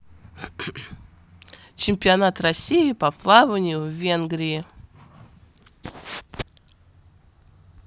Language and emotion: Russian, positive